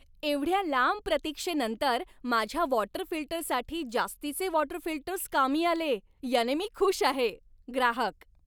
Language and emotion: Marathi, happy